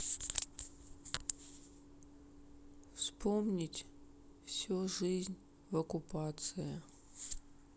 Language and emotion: Russian, sad